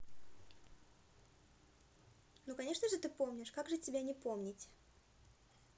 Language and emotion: Russian, positive